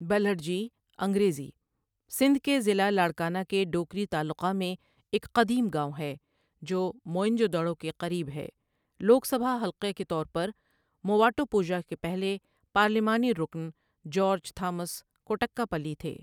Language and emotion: Urdu, neutral